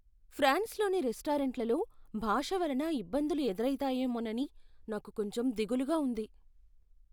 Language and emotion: Telugu, fearful